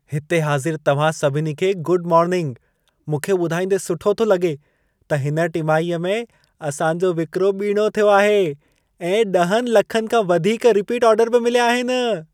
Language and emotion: Sindhi, happy